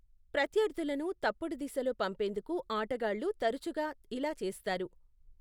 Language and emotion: Telugu, neutral